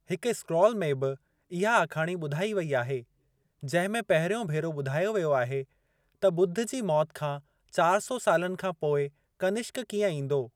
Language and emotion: Sindhi, neutral